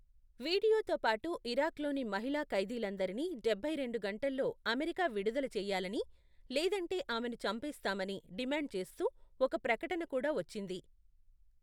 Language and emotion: Telugu, neutral